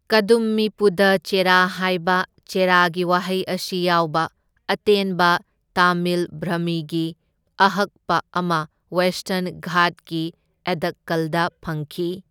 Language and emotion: Manipuri, neutral